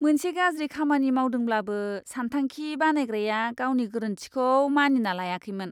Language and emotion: Bodo, disgusted